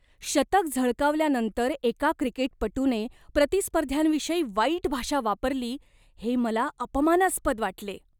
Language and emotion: Marathi, disgusted